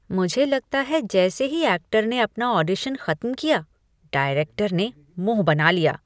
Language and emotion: Hindi, disgusted